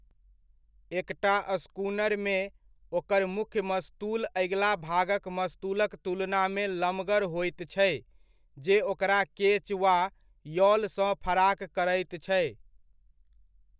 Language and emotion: Maithili, neutral